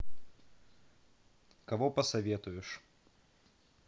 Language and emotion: Russian, neutral